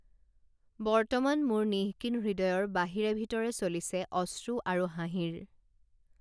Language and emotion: Assamese, neutral